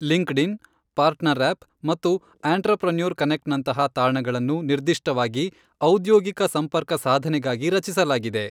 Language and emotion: Kannada, neutral